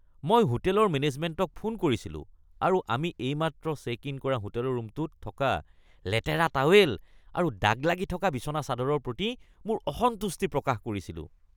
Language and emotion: Assamese, disgusted